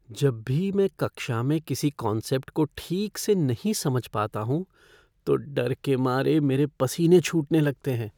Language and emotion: Hindi, fearful